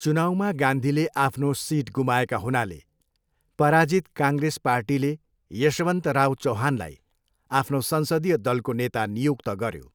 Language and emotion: Nepali, neutral